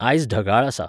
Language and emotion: Goan Konkani, neutral